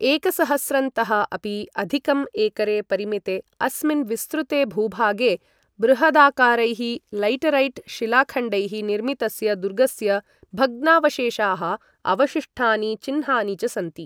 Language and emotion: Sanskrit, neutral